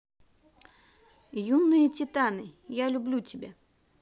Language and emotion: Russian, positive